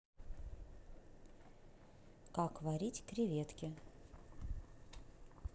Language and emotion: Russian, neutral